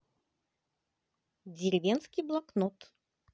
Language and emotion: Russian, positive